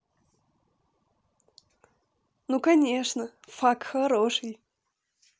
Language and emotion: Russian, positive